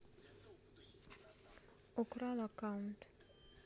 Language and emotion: Russian, neutral